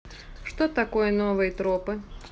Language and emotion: Russian, neutral